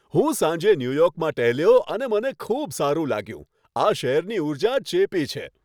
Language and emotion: Gujarati, happy